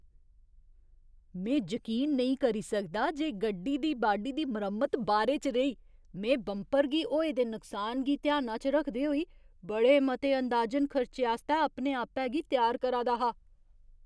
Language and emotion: Dogri, surprised